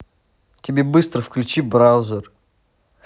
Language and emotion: Russian, angry